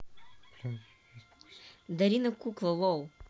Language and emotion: Russian, neutral